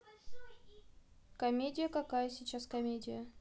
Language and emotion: Russian, neutral